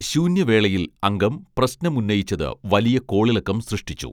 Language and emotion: Malayalam, neutral